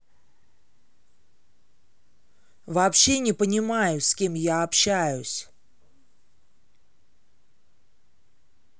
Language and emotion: Russian, angry